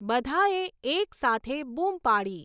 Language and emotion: Gujarati, neutral